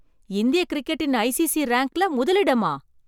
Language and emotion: Tamil, surprised